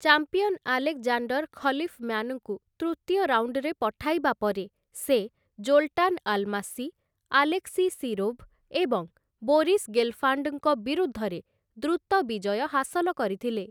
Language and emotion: Odia, neutral